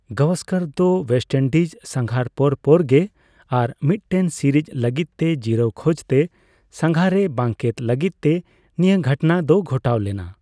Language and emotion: Santali, neutral